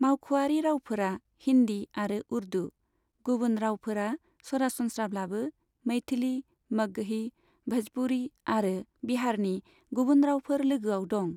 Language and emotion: Bodo, neutral